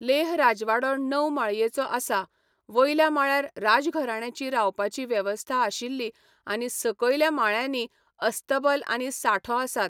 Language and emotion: Goan Konkani, neutral